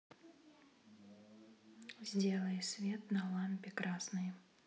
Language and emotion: Russian, neutral